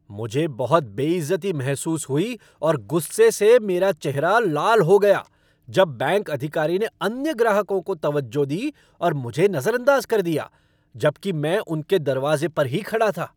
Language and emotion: Hindi, angry